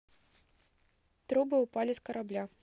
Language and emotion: Russian, neutral